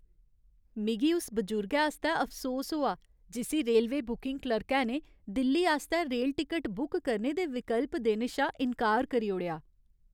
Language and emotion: Dogri, sad